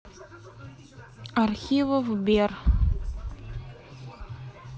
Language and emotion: Russian, neutral